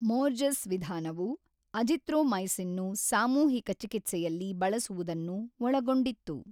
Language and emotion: Kannada, neutral